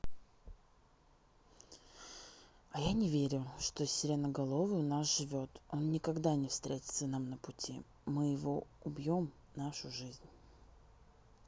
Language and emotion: Russian, neutral